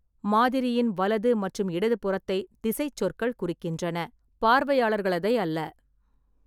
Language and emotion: Tamil, neutral